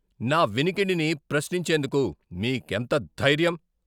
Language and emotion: Telugu, angry